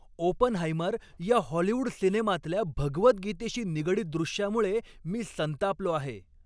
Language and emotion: Marathi, angry